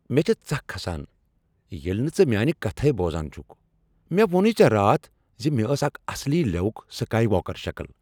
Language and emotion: Kashmiri, angry